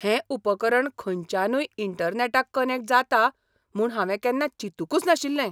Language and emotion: Goan Konkani, surprised